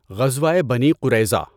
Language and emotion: Urdu, neutral